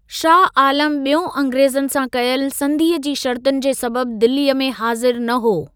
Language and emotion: Sindhi, neutral